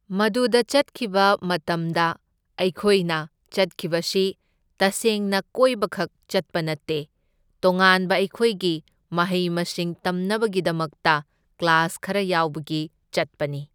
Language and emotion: Manipuri, neutral